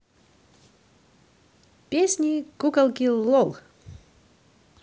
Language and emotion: Russian, positive